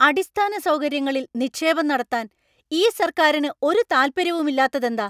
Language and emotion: Malayalam, angry